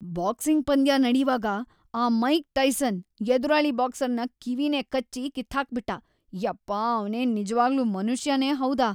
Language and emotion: Kannada, disgusted